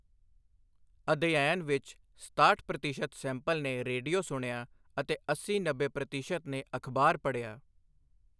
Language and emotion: Punjabi, neutral